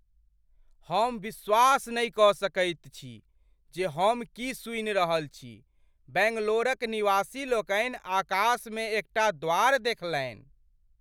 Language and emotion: Maithili, surprised